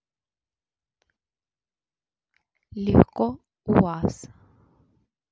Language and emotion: Russian, neutral